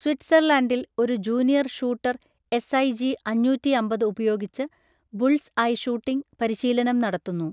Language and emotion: Malayalam, neutral